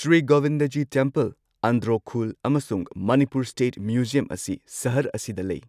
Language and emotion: Manipuri, neutral